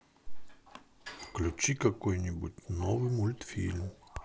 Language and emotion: Russian, neutral